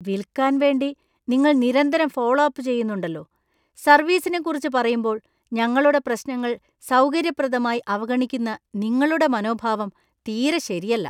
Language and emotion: Malayalam, disgusted